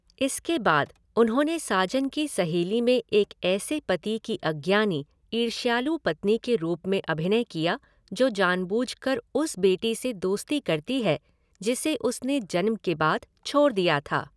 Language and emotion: Hindi, neutral